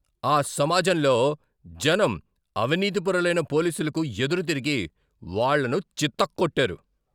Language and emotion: Telugu, angry